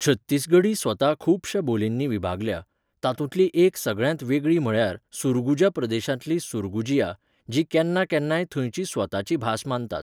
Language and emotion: Goan Konkani, neutral